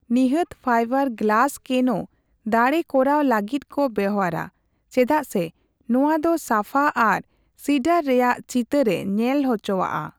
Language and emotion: Santali, neutral